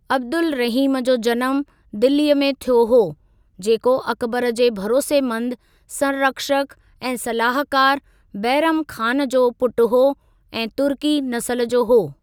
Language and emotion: Sindhi, neutral